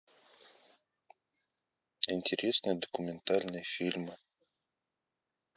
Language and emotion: Russian, neutral